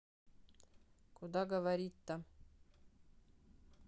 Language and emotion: Russian, neutral